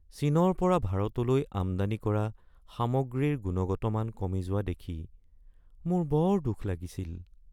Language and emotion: Assamese, sad